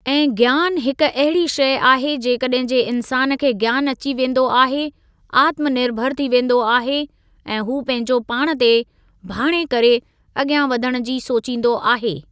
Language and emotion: Sindhi, neutral